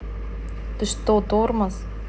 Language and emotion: Russian, neutral